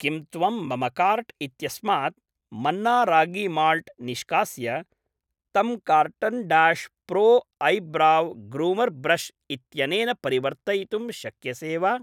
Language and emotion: Sanskrit, neutral